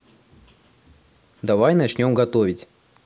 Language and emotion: Russian, positive